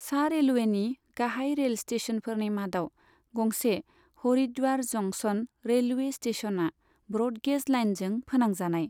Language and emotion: Bodo, neutral